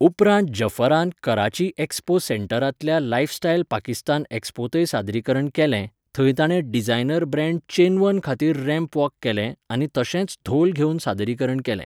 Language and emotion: Goan Konkani, neutral